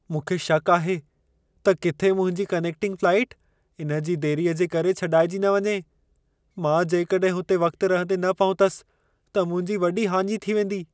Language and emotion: Sindhi, fearful